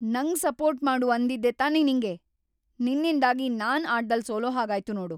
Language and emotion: Kannada, angry